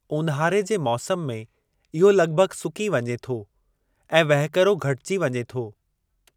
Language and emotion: Sindhi, neutral